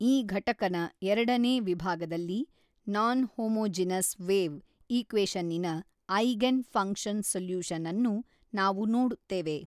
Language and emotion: Kannada, neutral